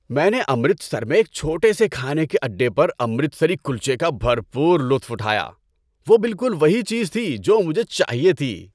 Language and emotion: Urdu, happy